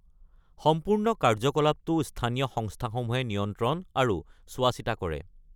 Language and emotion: Assamese, neutral